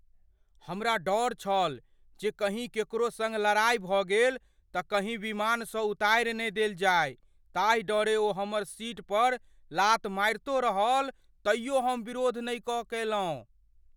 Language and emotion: Maithili, fearful